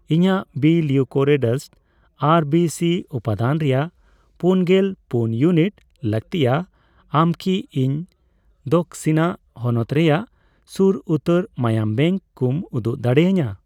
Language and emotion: Santali, neutral